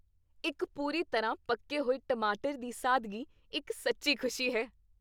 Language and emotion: Punjabi, happy